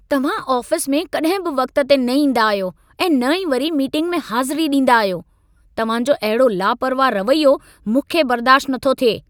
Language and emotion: Sindhi, angry